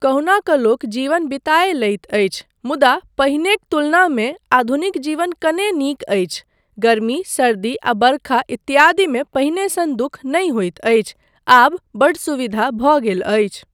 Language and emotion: Maithili, neutral